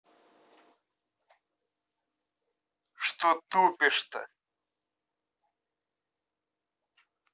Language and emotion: Russian, angry